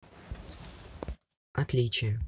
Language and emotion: Russian, neutral